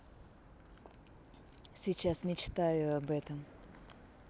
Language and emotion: Russian, positive